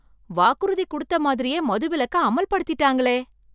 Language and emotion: Tamil, surprised